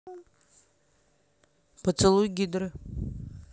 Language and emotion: Russian, neutral